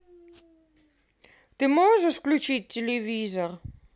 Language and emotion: Russian, neutral